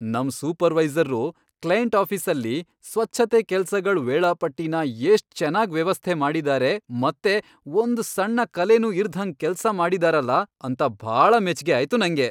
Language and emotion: Kannada, happy